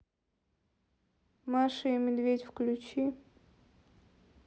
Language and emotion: Russian, neutral